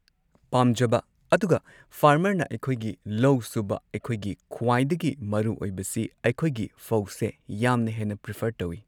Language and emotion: Manipuri, neutral